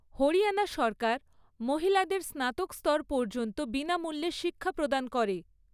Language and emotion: Bengali, neutral